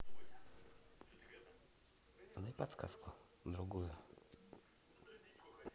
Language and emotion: Russian, neutral